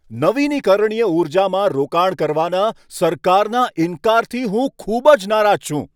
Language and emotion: Gujarati, angry